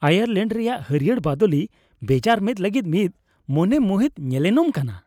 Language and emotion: Santali, happy